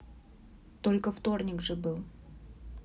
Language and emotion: Russian, neutral